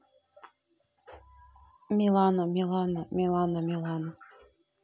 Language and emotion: Russian, neutral